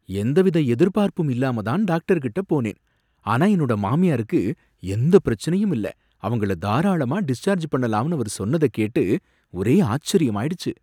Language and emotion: Tamil, surprised